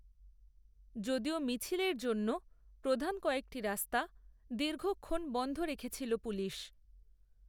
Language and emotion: Bengali, neutral